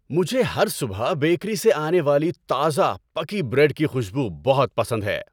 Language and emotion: Urdu, happy